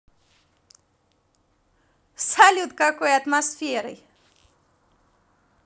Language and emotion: Russian, positive